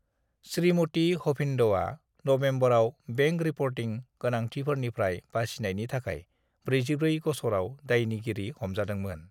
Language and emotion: Bodo, neutral